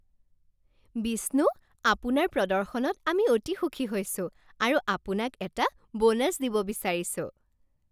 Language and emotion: Assamese, happy